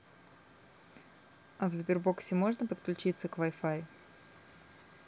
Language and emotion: Russian, neutral